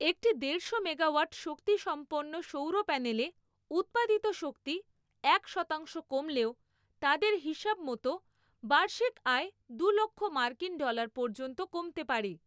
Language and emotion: Bengali, neutral